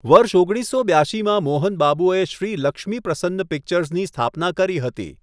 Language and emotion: Gujarati, neutral